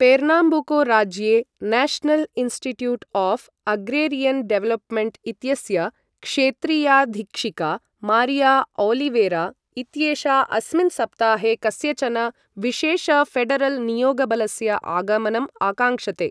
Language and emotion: Sanskrit, neutral